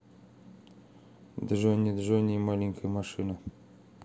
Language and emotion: Russian, neutral